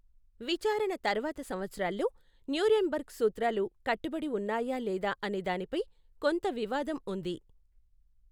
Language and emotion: Telugu, neutral